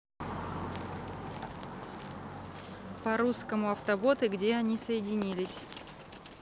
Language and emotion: Russian, neutral